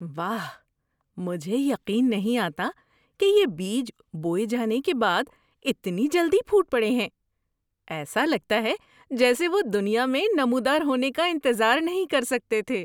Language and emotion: Urdu, surprised